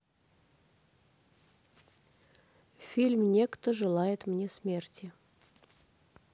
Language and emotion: Russian, neutral